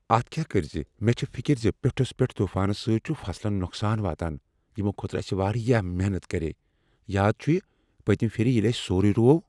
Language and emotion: Kashmiri, fearful